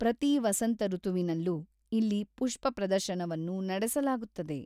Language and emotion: Kannada, neutral